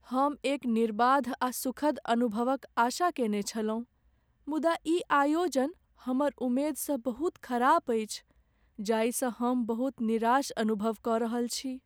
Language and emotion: Maithili, sad